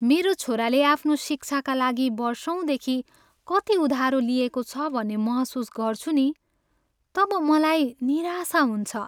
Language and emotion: Nepali, sad